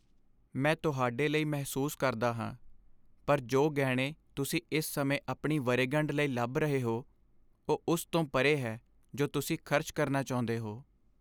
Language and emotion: Punjabi, sad